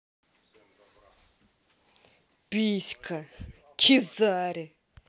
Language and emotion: Russian, angry